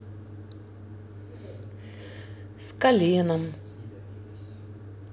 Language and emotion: Russian, sad